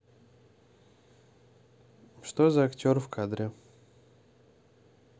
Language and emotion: Russian, neutral